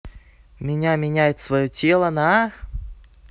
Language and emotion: Russian, neutral